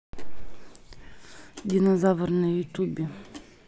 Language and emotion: Russian, neutral